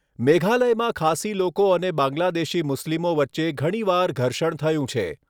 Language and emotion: Gujarati, neutral